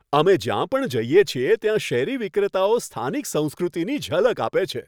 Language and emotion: Gujarati, happy